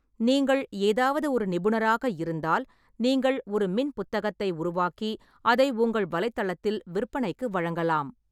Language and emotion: Tamil, neutral